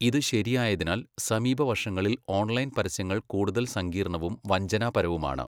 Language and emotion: Malayalam, neutral